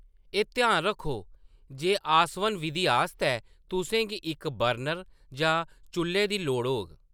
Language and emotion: Dogri, neutral